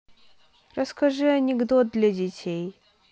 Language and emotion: Russian, neutral